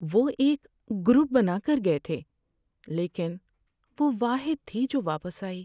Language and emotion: Urdu, sad